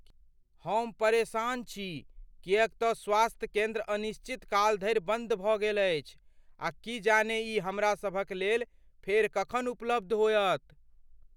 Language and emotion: Maithili, fearful